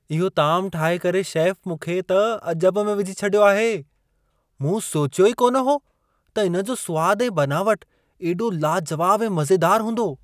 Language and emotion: Sindhi, surprised